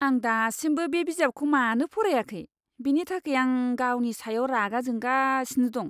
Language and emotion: Bodo, disgusted